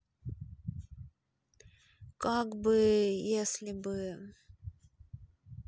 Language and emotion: Russian, neutral